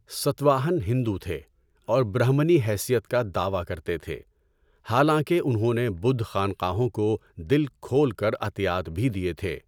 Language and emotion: Urdu, neutral